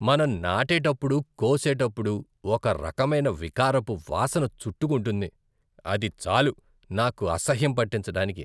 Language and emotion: Telugu, disgusted